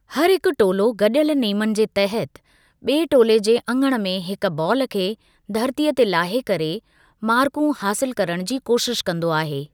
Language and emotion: Sindhi, neutral